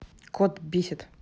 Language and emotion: Russian, angry